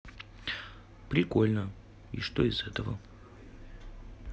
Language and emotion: Russian, neutral